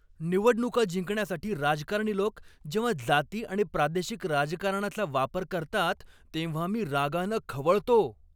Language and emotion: Marathi, angry